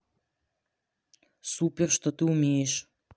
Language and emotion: Russian, neutral